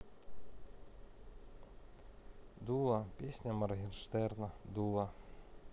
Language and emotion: Russian, neutral